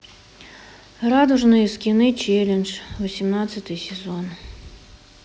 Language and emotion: Russian, sad